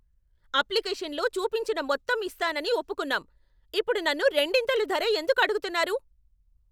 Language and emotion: Telugu, angry